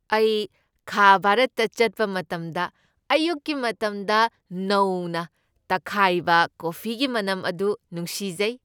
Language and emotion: Manipuri, happy